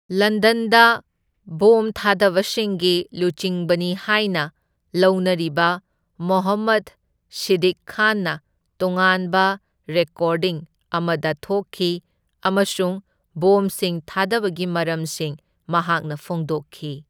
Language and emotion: Manipuri, neutral